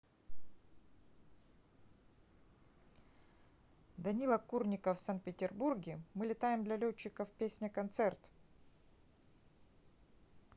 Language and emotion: Russian, neutral